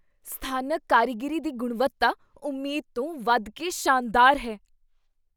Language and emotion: Punjabi, surprised